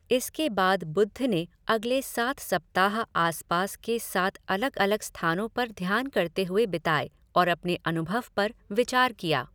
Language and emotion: Hindi, neutral